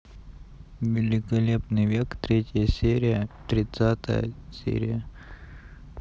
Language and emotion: Russian, neutral